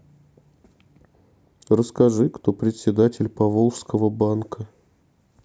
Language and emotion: Russian, neutral